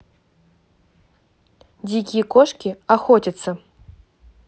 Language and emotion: Russian, angry